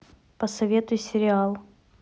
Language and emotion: Russian, neutral